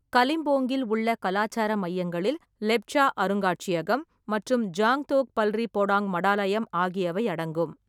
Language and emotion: Tamil, neutral